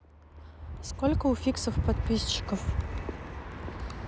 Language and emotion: Russian, neutral